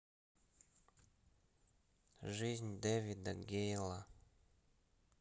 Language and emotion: Russian, neutral